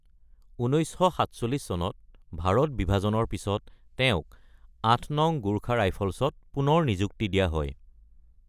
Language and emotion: Assamese, neutral